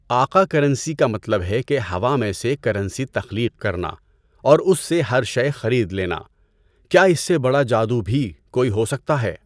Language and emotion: Urdu, neutral